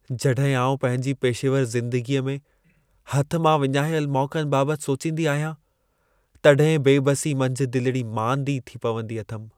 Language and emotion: Sindhi, sad